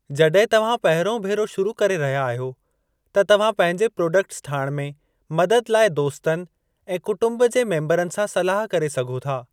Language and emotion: Sindhi, neutral